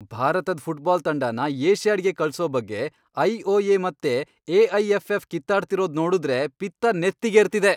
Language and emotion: Kannada, angry